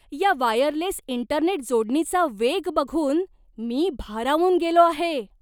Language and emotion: Marathi, surprised